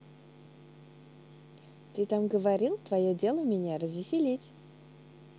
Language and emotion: Russian, positive